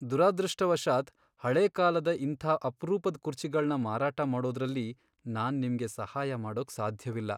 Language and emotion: Kannada, sad